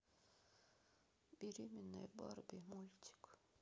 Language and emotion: Russian, neutral